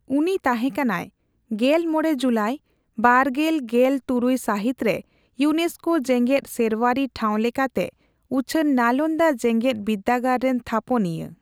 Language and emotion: Santali, neutral